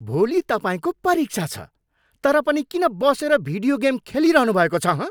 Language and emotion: Nepali, angry